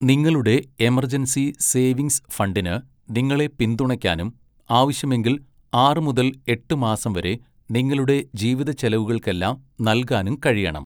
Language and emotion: Malayalam, neutral